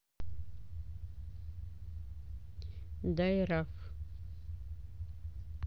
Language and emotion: Russian, neutral